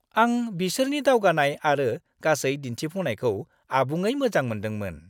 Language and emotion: Bodo, happy